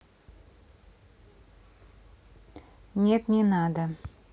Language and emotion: Russian, neutral